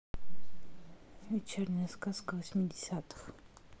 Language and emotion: Russian, neutral